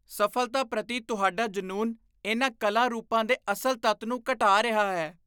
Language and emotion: Punjabi, disgusted